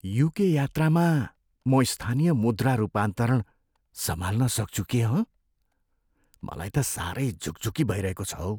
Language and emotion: Nepali, fearful